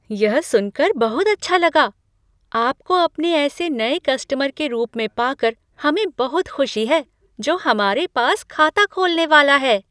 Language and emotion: Hindi, surprised